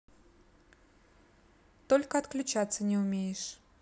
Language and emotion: Russian, neutral